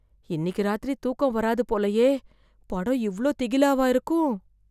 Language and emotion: Tamil, fearful